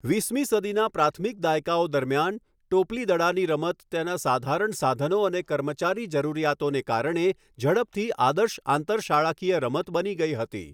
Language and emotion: Gujarati, neutral